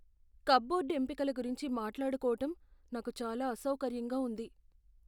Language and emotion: Telugu, fearful